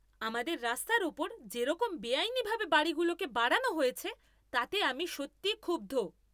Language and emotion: Bengali, angry